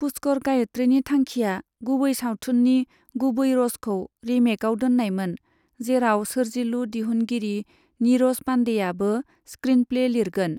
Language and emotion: Bodo, neutral